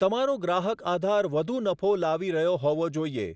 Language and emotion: Gujarati, neutral